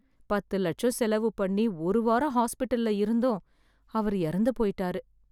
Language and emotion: Tamil, sad